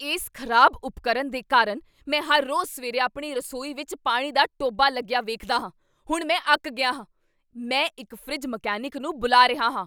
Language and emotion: Punjabi, angry